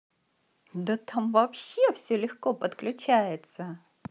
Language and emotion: Russian, positive